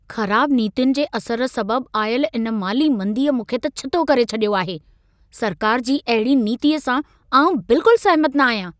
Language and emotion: Sindhi, angry